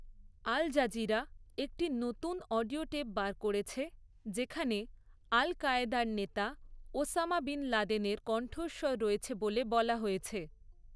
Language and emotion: Bengali, neutral